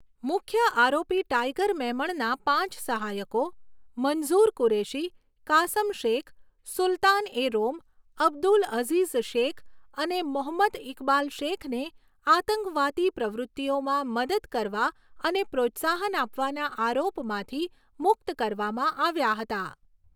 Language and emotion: Gujarati, neutral